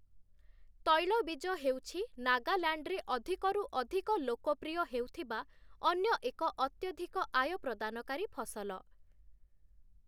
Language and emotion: Odia, neutral